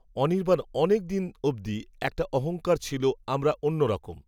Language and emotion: Bengali, neutral